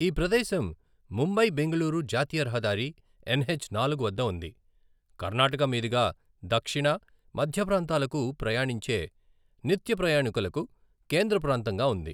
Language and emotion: Telugu, neutral